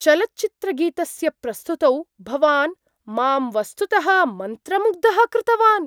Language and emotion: Sanskrit, surprised